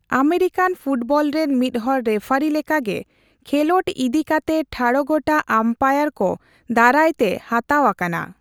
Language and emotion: Santali, neutral